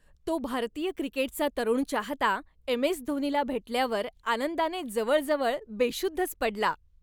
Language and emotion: Marathi, happy